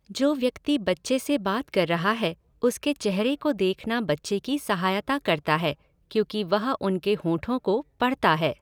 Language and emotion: Hindi, neutral